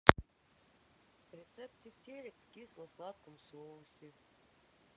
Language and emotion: Russian, sad